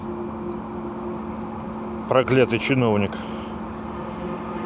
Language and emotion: Russian, neutral